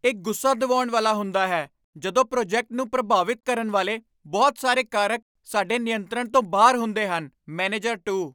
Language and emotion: Punjabi, angry